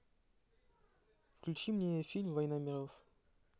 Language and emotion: Russian, neutral